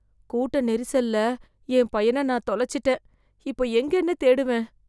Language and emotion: Tamil, fearful